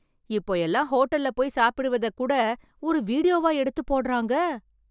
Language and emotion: Tamil, surprised